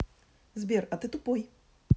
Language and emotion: Russian, angry